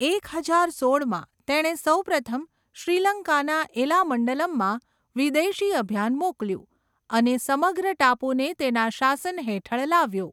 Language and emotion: Gujarati, neutral